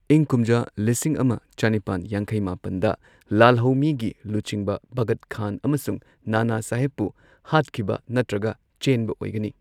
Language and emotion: Manipuri, neutral